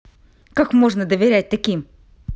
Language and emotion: Russian, angry